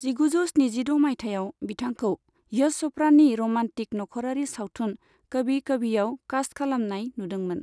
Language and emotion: Bodo, neutral